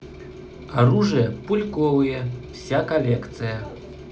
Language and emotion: Russian, neutral